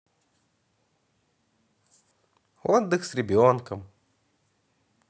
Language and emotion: Russian, positive